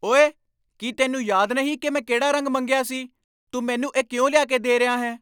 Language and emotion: Punjabi, angry